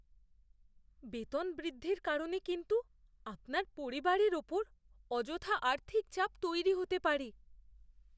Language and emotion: Bengali, fearful